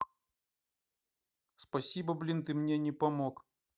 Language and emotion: Russian, angry